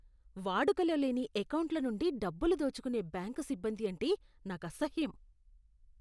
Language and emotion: Telugu, disgusted